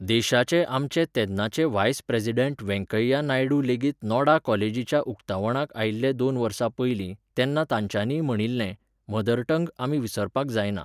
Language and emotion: Goan Konkani, neutral